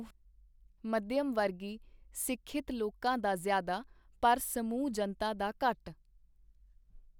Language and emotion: Punjabi, neutral